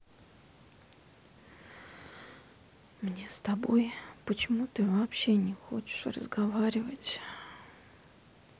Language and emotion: Russian, sad